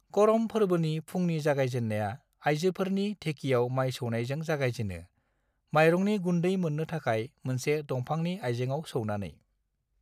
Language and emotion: Bodo, neutral